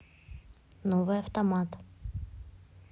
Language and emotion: Russian, neutral